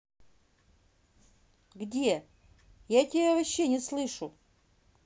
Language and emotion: Russian, neutral